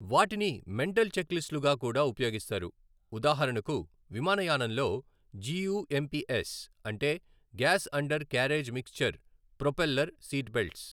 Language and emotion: Telugu, neutral